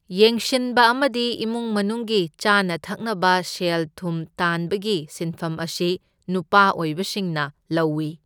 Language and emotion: Manipuri, neutral